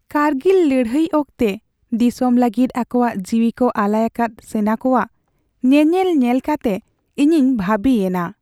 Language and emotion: Santali, sad